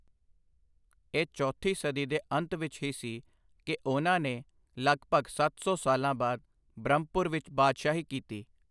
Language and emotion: Punjabi, neutral